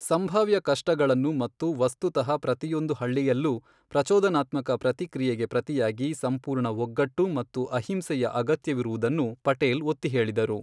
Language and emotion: Kannada, neutral